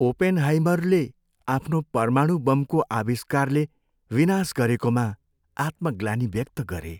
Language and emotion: Nepali, sad